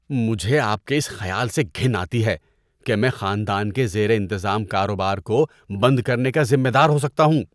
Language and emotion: Urdu, disgusted